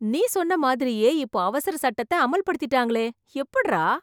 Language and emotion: Tamil, surprised